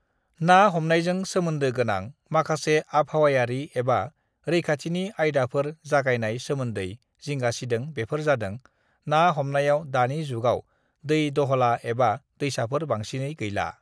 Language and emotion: Bodo, neutral